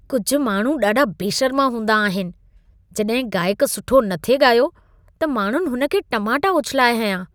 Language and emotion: Sindhi, disgusted